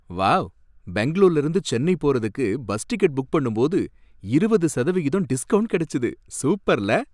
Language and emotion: Tamil, happy